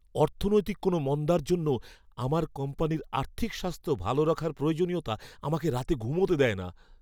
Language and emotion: Bengali, fearful